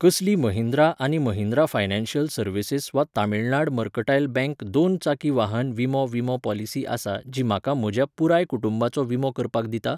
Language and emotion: Goan Konkani, neutral